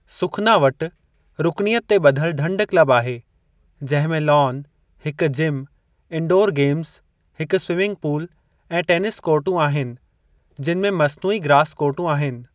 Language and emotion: Sindhi, neutral